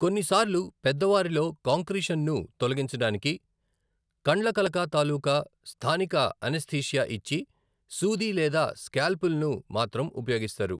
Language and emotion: Telugu, neutral